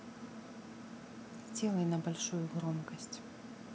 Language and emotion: Russian, neutral